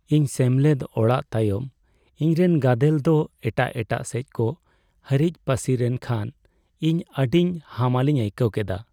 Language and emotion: Santali, sad